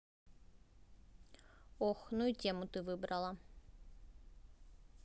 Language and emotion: Russian, neutral